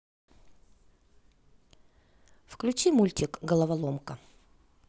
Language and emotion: Russian, neutral